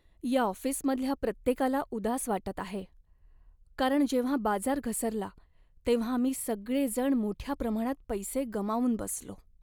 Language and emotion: Marathi, sad